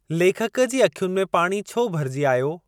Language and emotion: Sindhi, neutral